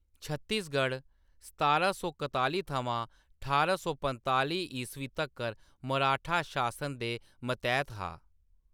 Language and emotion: Dogri, neutral